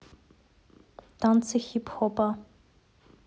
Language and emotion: Russian, neutral